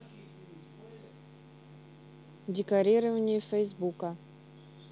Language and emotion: Russian, neutral